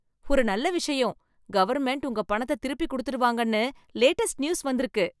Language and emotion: Tamil, happy